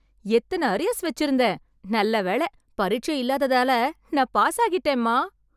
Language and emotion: Tamil, happy